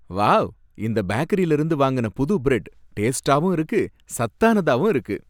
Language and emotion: Tamil, happy